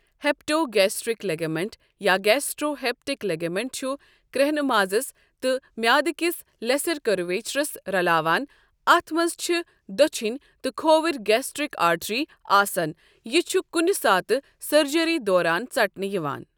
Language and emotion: Kashmiri, neutral